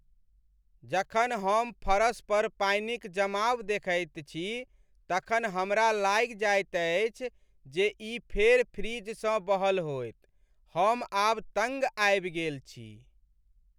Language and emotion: Maithili, sad